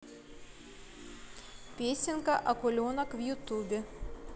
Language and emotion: Russian, neutral